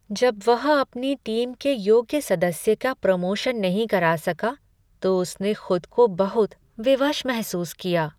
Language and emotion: Hindi, sad